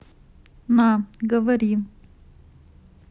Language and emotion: Russian, neutral